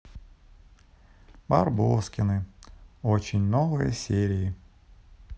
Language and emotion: Russian, sad